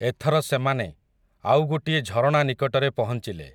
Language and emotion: Odia, neutral